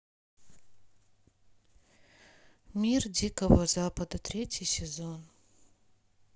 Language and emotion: Russian, sad